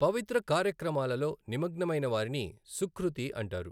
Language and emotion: Telugu, neutral